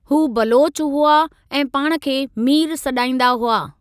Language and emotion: Sindhi, neutral